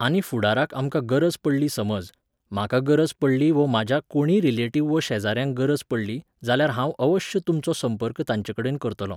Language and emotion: Goan Konkani, neutral